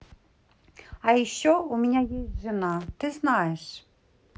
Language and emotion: Russian, neutral